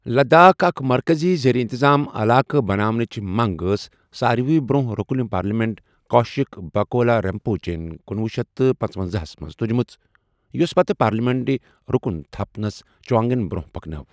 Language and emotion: Kashmiri, neutral